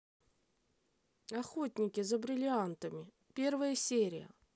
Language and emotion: Russian, neutral